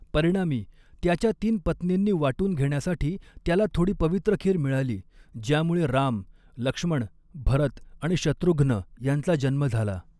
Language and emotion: Marathi, neutral